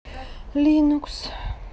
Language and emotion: Russian, sad